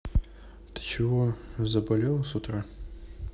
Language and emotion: Russian, neutral